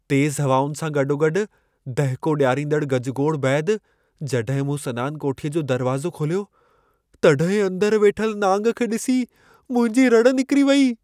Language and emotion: Sindhi, fearful